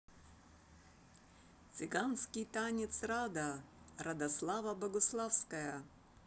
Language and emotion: Russian, positive